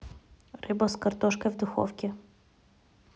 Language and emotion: Russian, neutral